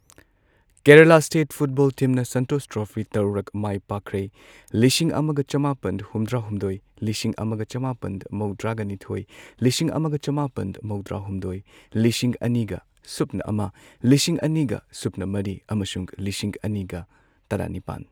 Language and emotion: Manipuri, neutral